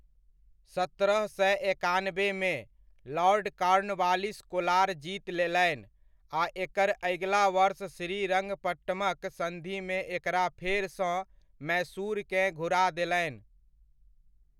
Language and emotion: Maithili, neutral